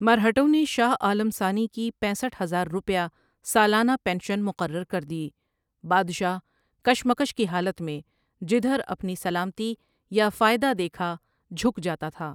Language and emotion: Urdu, neutral